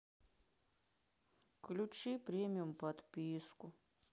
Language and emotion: Russian, sad